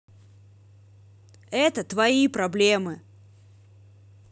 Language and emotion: Russian, angry